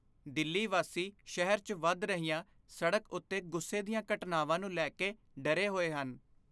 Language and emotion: Punjabi, fearful